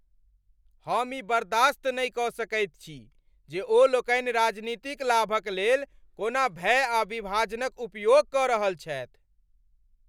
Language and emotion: Maithili, angry